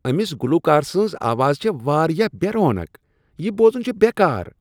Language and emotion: Kashmiri, disgusted